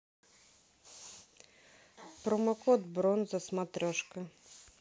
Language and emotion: Russian, neutral